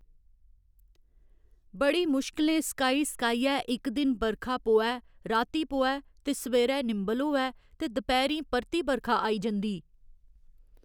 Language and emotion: Dogri, neutral